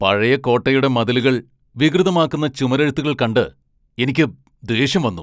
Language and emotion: Malayalam, angry